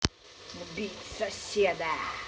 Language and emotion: Russian, angry